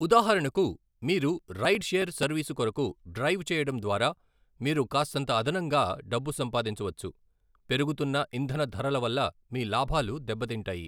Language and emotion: Telugu, neutral